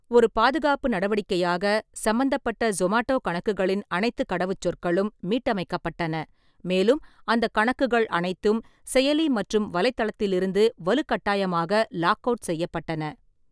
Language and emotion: Tamil, neutral